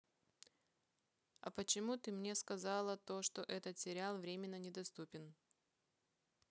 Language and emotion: Russian, neutral